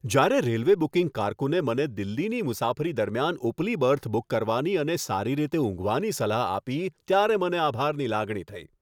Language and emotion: Gujarati, happy